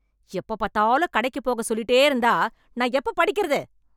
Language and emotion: Tamil, angry